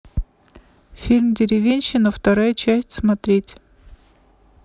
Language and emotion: Russian, neutral